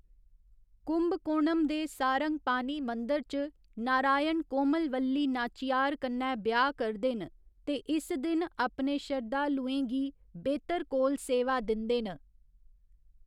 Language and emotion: Dogri, neutral